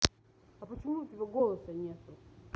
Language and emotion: Russian, angry